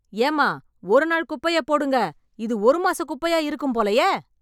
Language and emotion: Tamil, angry